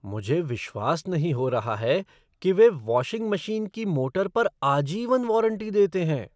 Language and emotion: Hindi, surprised